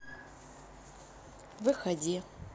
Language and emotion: Russian, neutral